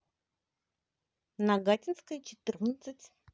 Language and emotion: Russian, positive